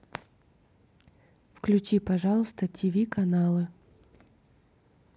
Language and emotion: Russian, neutral